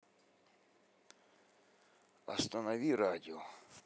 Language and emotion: Russian, neutral